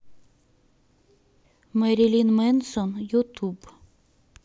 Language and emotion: Russian, neutral